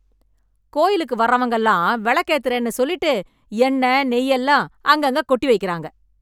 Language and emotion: Tamil, angry